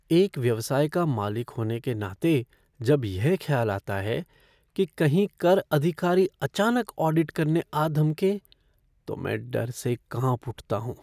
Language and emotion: Hindi, fearful